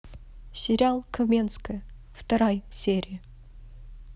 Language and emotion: Russian, neutral